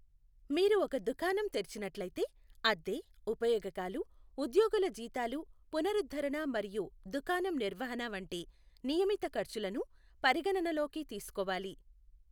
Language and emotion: Telugu, neutral